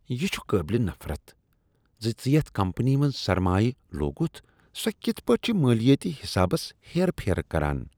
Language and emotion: Kashmiri, disgusted